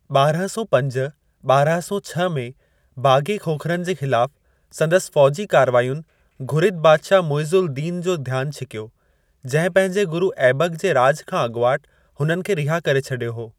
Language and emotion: Sindhi, neutral